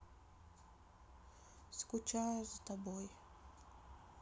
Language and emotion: Russian, sad